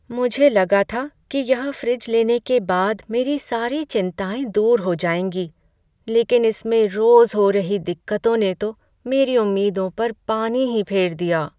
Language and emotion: Hindi, sad